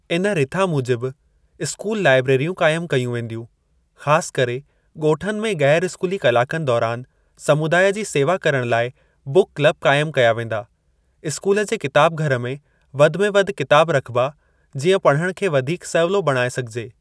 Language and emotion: Sindhi, neutral